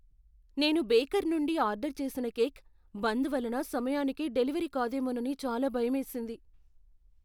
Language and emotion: Telugu, fearful